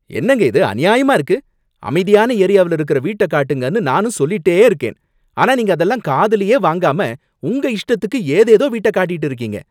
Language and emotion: Tamil, angry